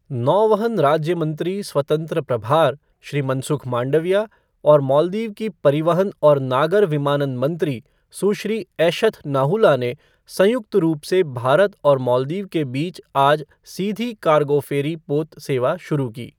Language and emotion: Hindi, neutral